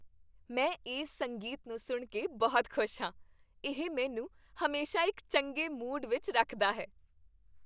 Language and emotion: Punjabi, happy